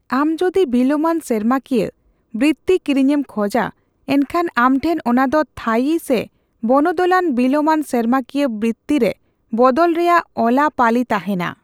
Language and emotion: Santali, neutral